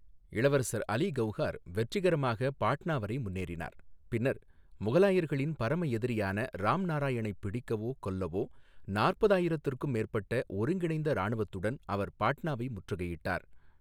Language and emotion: Tamil, neutral